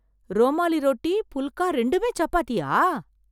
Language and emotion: Tamil, surprised